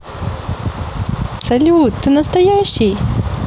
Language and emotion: Russian, positive